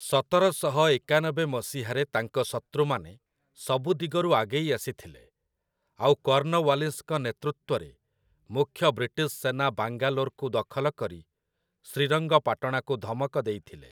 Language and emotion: Odia, neutral